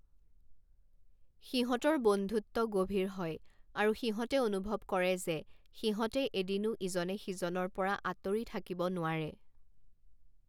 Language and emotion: Assamese, neutral